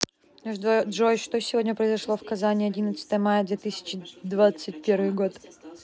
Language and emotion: Russian, neutral